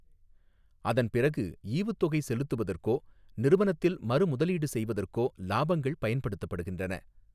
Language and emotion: Tamil, neutral